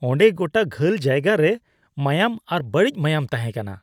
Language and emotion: Santali, disgusted